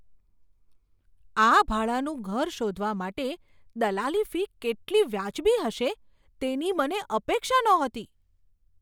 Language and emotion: Gujarati, surprised